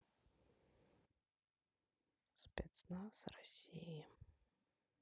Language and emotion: Russian, neutral